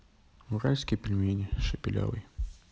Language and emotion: Russian, neutral